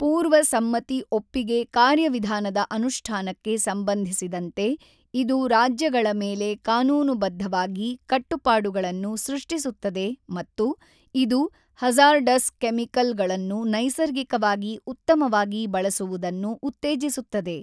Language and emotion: Kannada, neutral